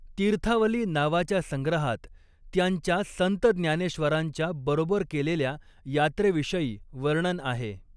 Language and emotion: Marathi, neutral